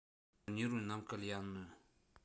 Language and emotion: Russian, neutral